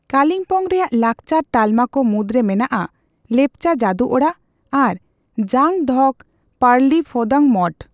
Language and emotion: Santali, neutral